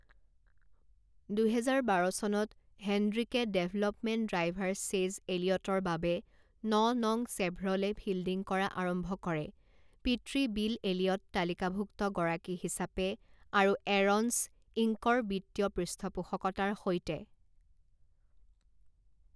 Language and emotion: Assamese, neutral